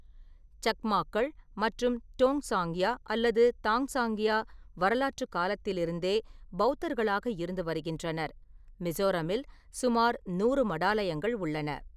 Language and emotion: Tamil, neutral